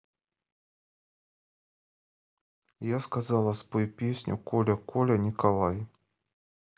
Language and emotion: Russian, neutral